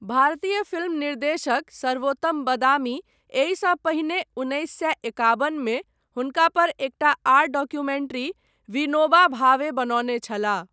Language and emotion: Maithili, neutral